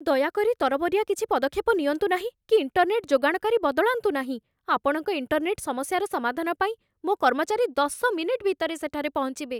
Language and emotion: Odia, fearful